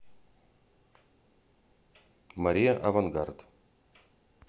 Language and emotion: Russian, neutral